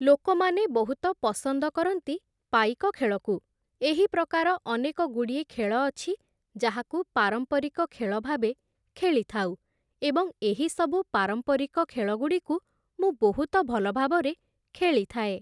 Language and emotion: Odia, neutral